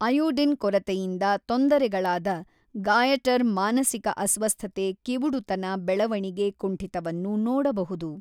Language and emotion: Kannada, neutral